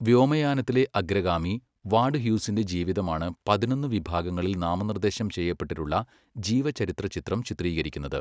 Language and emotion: Malayalam, neutral